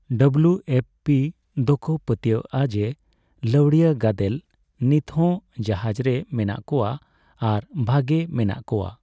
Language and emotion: Santali, neutral